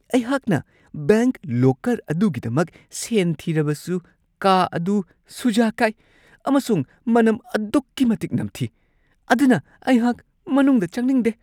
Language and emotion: Manipuri, disgusted